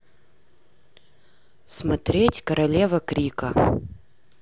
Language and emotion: Russian, neutral